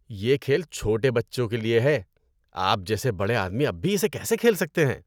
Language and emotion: Urdu, disgusted